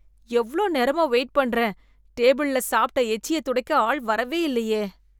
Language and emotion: Tamil, disgusted